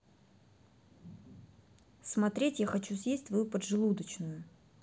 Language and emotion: Russian, neutral